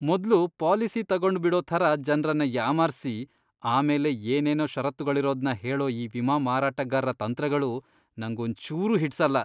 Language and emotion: Kannada, disgusted